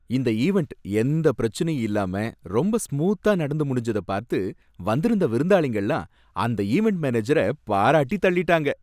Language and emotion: Tamil, happy